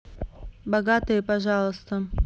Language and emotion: Russian, neutral